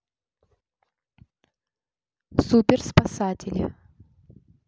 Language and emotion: Russian, neutral